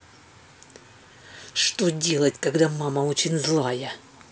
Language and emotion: Russian, angry